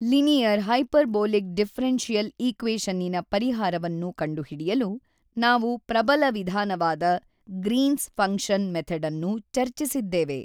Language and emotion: Kannada, neutral